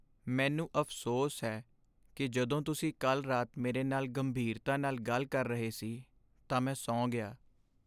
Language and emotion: Punjabi, sad